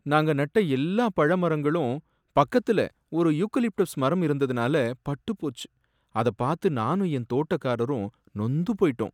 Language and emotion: Tamil, sad